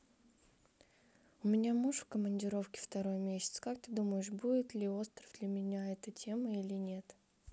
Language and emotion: Russian, neutral